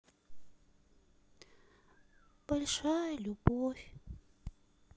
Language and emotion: Russian, sad